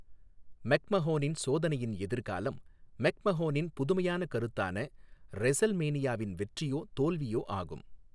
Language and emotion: Tamil, neutral